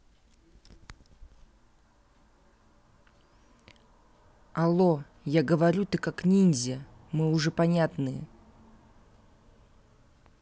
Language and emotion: Russian, angry